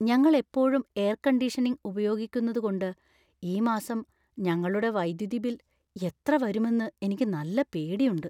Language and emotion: Malayalam, fearful